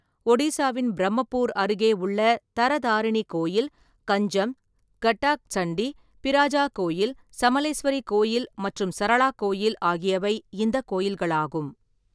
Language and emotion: Tamil, neutral